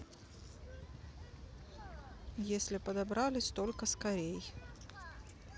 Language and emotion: Russian, neutral